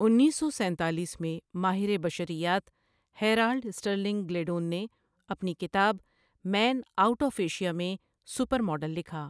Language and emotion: Urdu, neutral